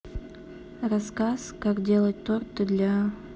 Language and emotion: Russian, neutral